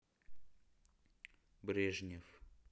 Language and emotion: Russian, neutral